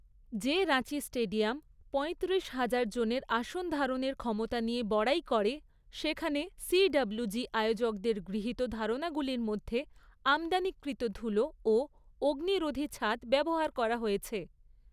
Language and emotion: Bengali, neutral